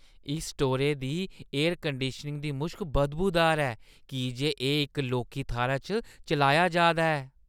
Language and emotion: Dogri, disgusted